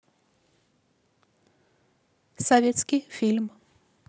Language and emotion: Russian, neutral